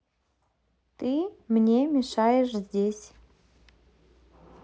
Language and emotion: Russian, neutral